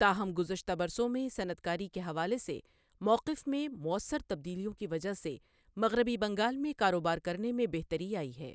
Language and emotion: Urdu, neutral